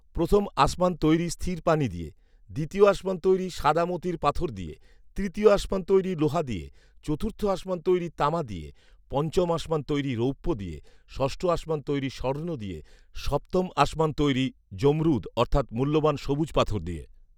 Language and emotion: Bengali, neutral